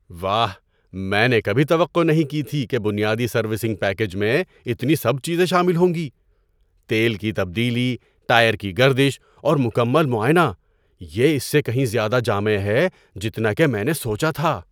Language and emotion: Urdu, surprised